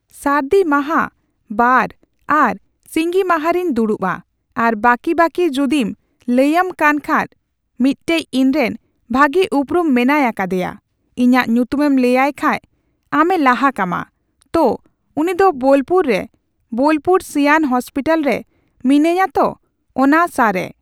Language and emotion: Santali, neutral